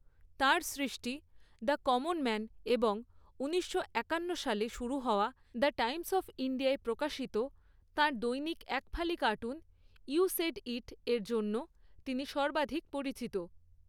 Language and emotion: Bengali, neutral